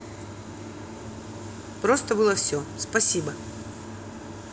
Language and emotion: Russian, neutral